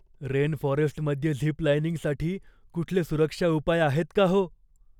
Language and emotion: Marathi, fearful